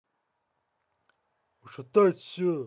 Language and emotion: Russian, angry